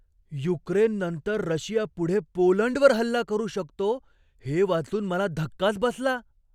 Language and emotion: Marathi, surprised